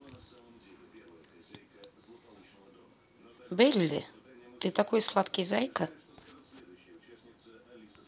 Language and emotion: Russian, neutral